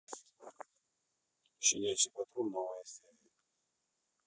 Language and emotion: Russian, neutral